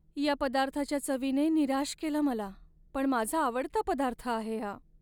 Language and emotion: Marathi, sad